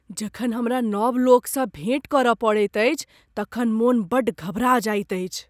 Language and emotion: Maithili, fearful